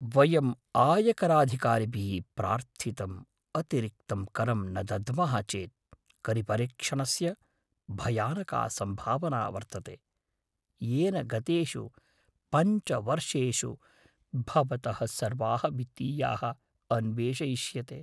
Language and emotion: Sanskrit, fearful